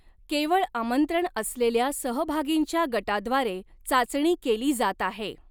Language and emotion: Marathi, neutral